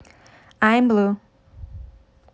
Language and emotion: Russian, neutral